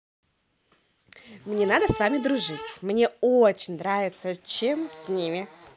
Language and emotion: Russian, positive